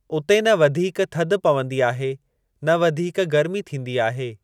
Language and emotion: Sindhi, neutral